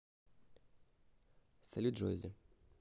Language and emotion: Russian, neutral